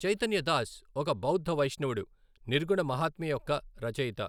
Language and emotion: Telugu, neutral